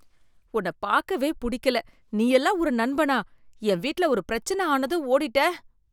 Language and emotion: Tamil, disgusted